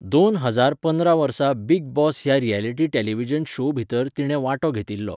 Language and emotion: Goan Konkani, neutral